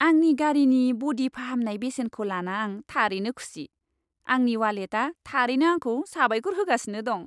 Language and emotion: Bodo, happy